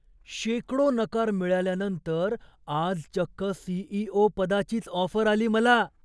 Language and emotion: Marathi, surprised